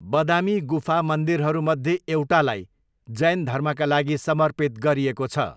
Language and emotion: Nepali, neutral